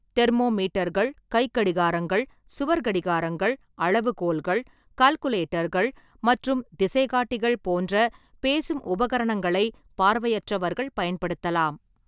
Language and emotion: Tamil, neutral